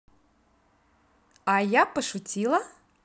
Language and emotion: Russian, positive